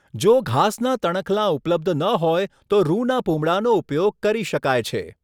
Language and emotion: Gujarati, neutral